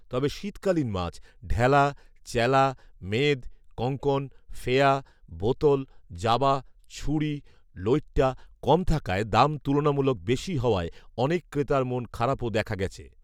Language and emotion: Bengali, neutral